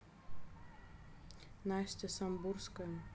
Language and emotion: Russian, neutral